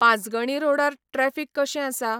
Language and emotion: Goan Konkani, neutral